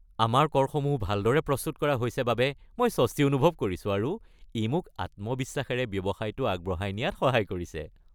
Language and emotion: Assamese, happy